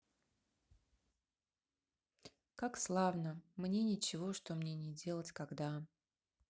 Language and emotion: Russian, sad